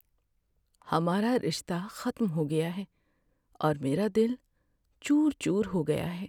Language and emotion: Urdu, sad